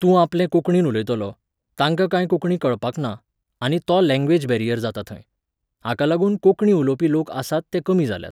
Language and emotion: Goan Konkani, neutral